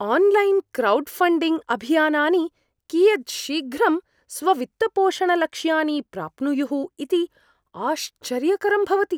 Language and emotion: Sanskrit, surprised